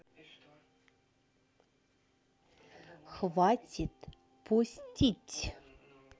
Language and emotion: Russian, neutral